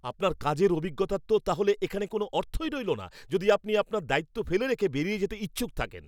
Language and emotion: Bengali, angry